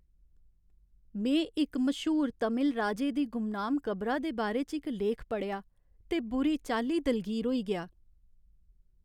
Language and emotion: Dogri, sad